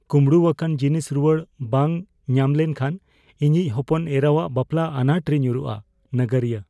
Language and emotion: Santali, fearful